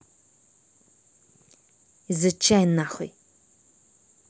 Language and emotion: Russian, angry